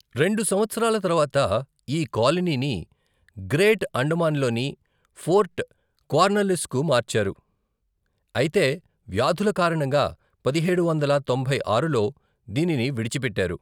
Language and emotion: Telugu, neutral